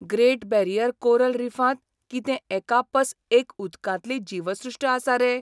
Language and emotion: Goan Konkani, surprised